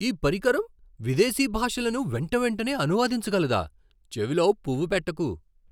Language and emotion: Telugu, surprised